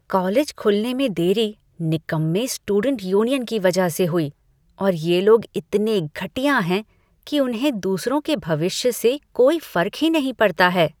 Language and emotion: Hindi, disgusted